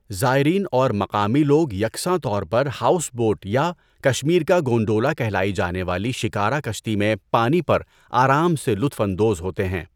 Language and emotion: Urdu, neutral